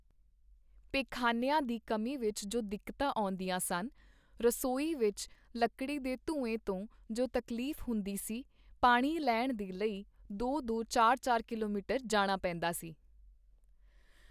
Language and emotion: Punjabi, neutral